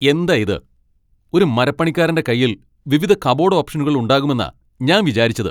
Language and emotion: Malayalam, angry